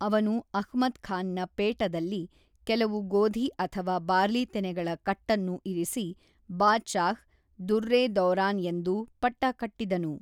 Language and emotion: Kannada, neutral